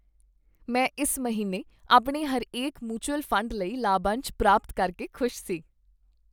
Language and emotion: Punjabi, happy